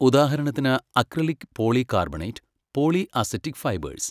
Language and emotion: Malayalam, neutral